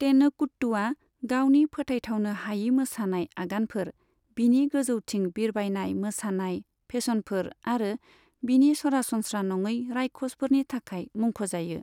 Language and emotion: Bodo, neutral